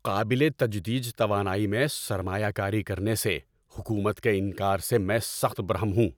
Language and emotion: Urdu, angry